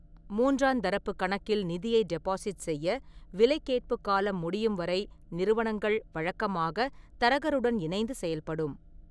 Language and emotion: Tamil, neutral